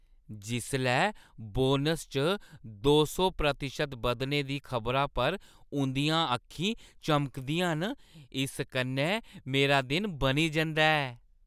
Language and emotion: Dogri, happy